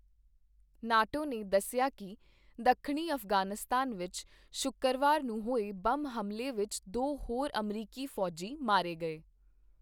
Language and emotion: Punjabi, neutral